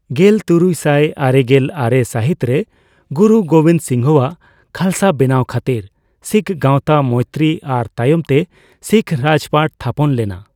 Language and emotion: Santali, neutral